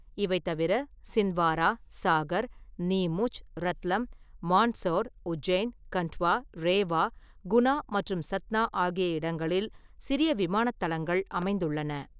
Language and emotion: Tamil, neutral